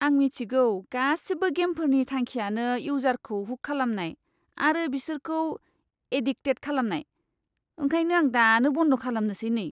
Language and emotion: Bodo, disgusted